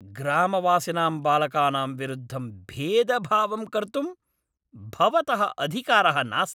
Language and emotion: Sanskrit, angry